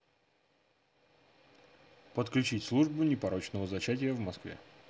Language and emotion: Russian, neutral